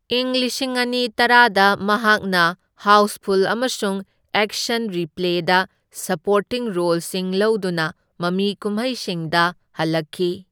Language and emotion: Manipuri, neutral